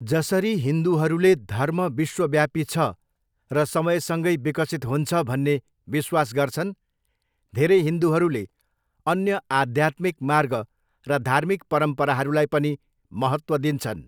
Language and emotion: Nepali, neutral